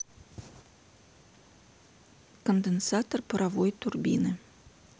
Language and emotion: Russian, neutral